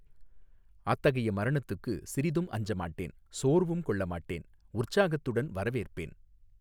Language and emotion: Tamil, neutral